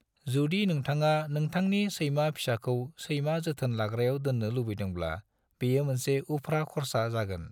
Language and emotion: Bodo, neutral